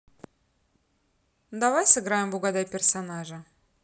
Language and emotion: Russian, neutral